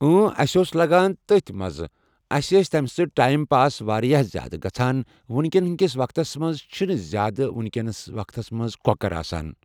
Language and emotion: Kashmiri, neutral